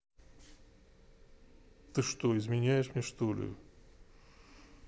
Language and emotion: Russian, sad